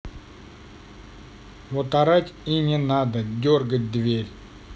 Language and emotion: Russian, neutral